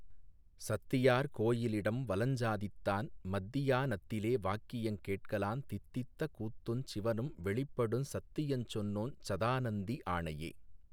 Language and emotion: Tamil, neutral